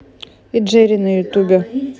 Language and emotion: Russian, neutral